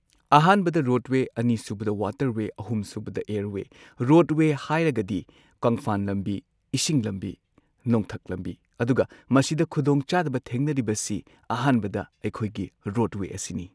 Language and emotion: Manipuri, neutral